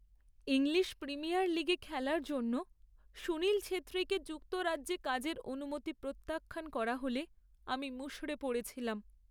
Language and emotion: Bengali, sad